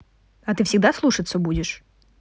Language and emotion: Russian, neutral